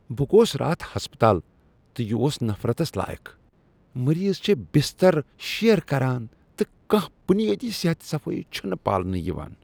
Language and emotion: Kashmiri, disgusted